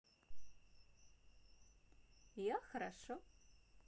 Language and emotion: Russian, positive